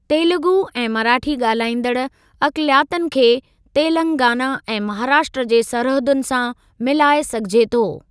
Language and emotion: Sindhi, neutral